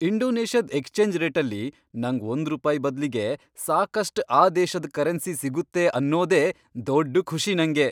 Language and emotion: Kannada, happy